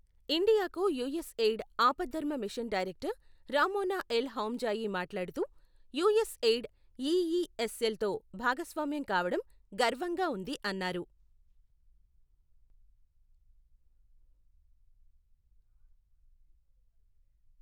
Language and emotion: Telugu, neutral